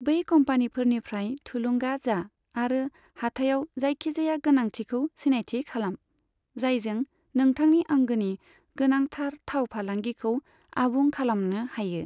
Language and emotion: Bodo, neutral